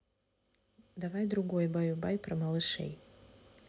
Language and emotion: Russian, neutral